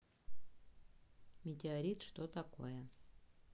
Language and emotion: Russian, neutral